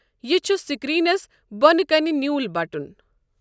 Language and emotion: Kashmiri, neutral